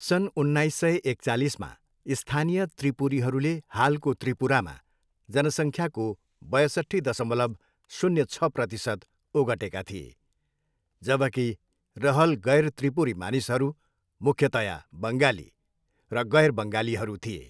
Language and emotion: Nepali, neutral